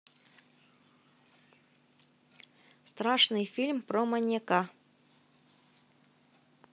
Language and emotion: Russian, neutral